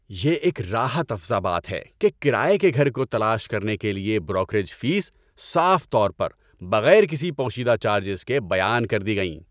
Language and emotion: Urdu, happy